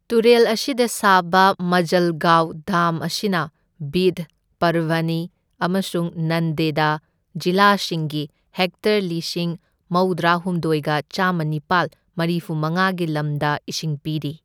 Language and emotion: Manipuri, neutral